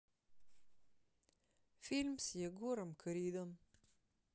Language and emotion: Russian, sad